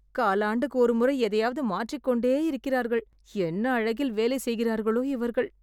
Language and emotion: Tamil, disgusted